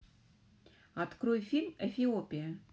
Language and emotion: Russian, positive